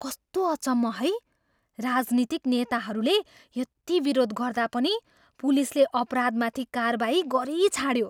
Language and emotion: Nepali, surprised